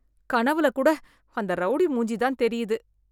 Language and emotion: Tamil, disgusted